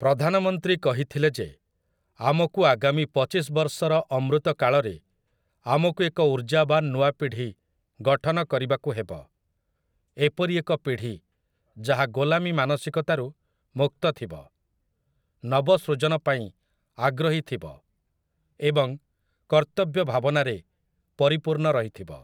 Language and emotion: Odia, neutral